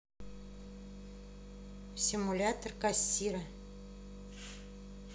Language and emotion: Russian, neutral